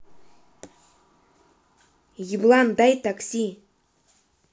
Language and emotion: Russian, angry